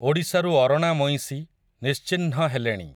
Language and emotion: Odia, neutral